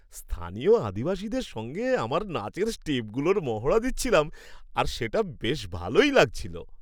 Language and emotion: Bengali, happy